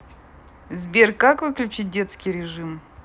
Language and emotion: Russian, neutral